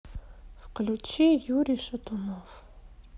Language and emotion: Russian, sad